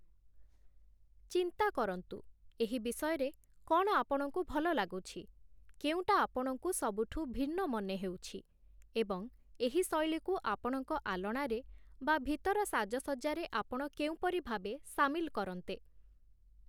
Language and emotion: Odia, neutral